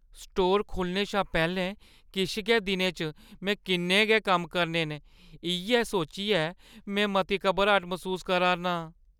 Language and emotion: Dogri, fearful